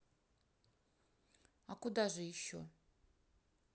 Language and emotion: Russian, neutral